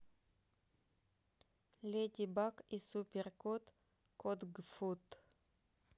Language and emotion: Russian, neutral